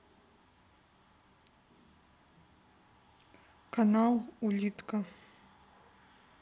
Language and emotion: Russian, neutral